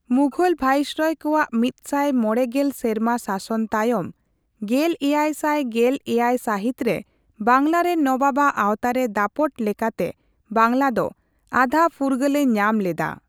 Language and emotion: Santali, neutral